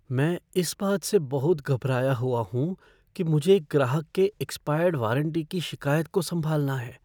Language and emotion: Hindi, fearful